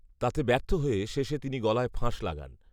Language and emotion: Bengali, neutral